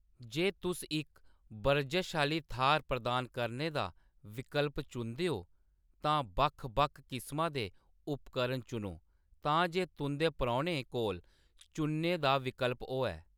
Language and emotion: Dogri, neutral